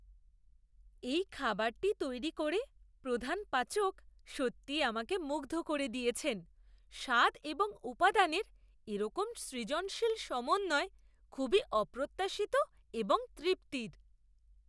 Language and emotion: Bengali, surprised